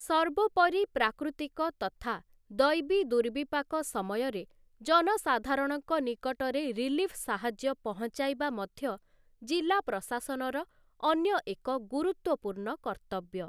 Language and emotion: Odia, neutral